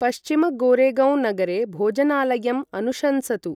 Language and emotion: Sanskrit, neutral